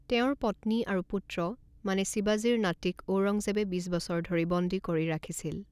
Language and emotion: Assamese, neutral